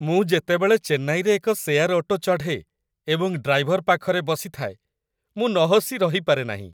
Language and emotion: Odia, happy